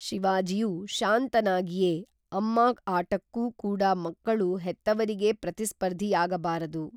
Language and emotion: Kannada, neutral